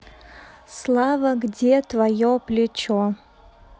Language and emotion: Russian, neutral